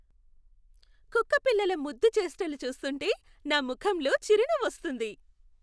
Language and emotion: Telugu, happy